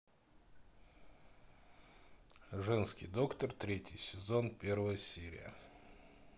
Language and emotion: Russian, neutral